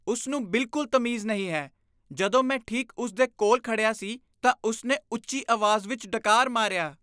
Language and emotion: Punjabi, disgusted